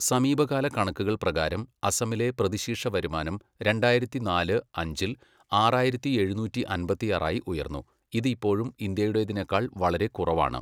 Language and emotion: Malayalam, neutral